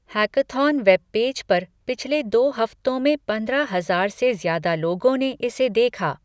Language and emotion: Hindi, neutral